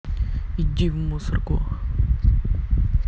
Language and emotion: Russian, angry